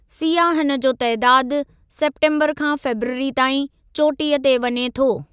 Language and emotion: Sindhi, neutral